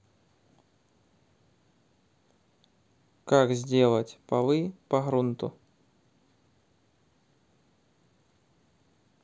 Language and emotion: Russian, neutral